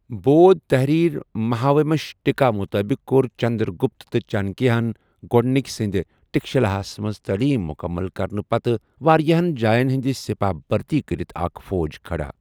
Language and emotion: Kashmiri, neutral